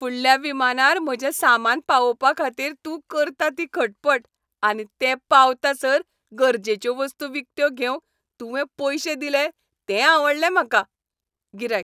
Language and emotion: Goan Konkani, happy